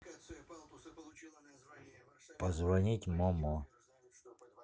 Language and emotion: Russian, neutral